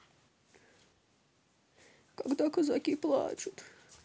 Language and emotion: Russian, sad